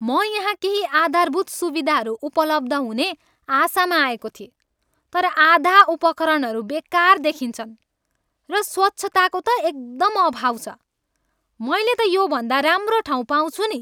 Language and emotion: Nepali, angry